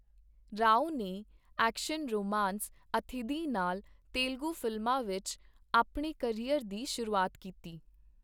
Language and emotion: Punjabi, neutral